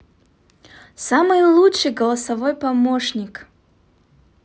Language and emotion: Russian, positive